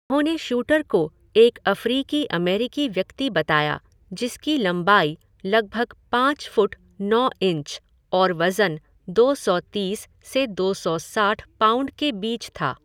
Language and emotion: Hindi, neutral